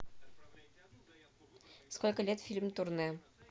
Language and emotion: Russian, neutral